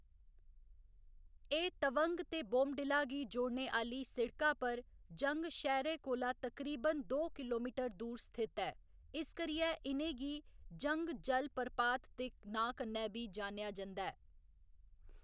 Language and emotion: Dogri, neutral